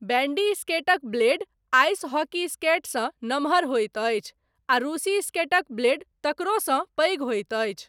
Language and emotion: Maithili, neutral